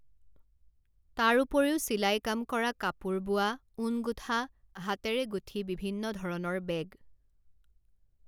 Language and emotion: Assamese, neutral